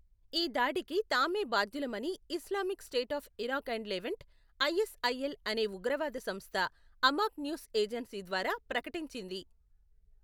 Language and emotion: Telugu, neutral